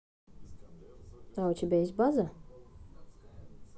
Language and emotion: Russian, neutral